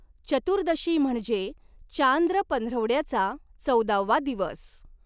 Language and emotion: Marathi, neutral